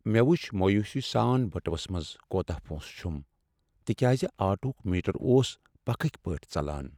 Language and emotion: Kashmiri, sad